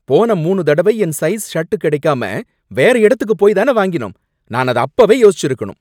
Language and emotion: Tamil, angry